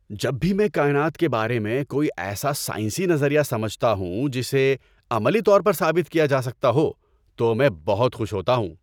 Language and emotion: Urdu, happy